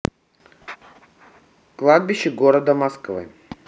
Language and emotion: Russian, neutral